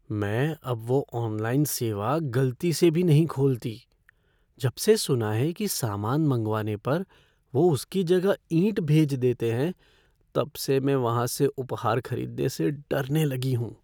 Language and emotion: Hindi, fearful